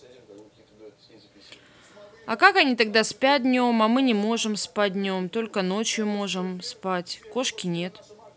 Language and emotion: Russian, neutral